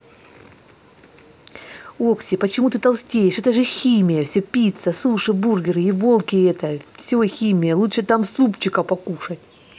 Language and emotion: Russian, angry